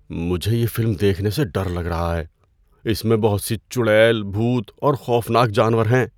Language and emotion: Urdu, fearful